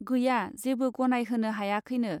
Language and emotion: Bodo, neutral